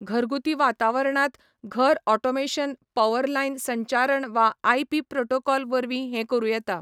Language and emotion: Goan Konkani, neutral